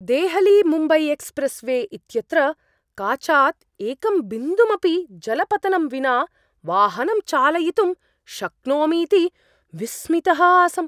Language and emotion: Sanskrit, surprised